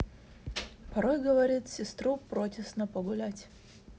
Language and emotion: Russian, neutral